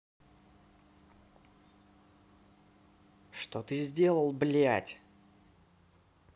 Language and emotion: Russian, angry